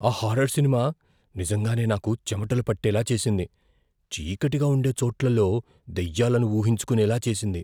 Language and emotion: Telugu, fearful